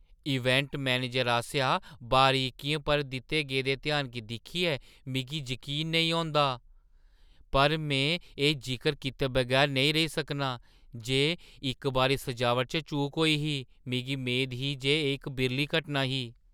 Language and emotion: Dogri, surprised